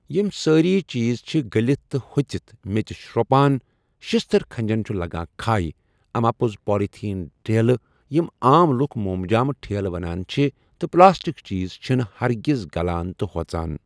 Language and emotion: Kashmiri, neutral